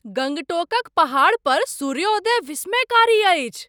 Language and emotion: Maithili, surprised